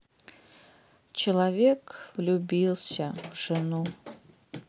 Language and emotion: Russian, sad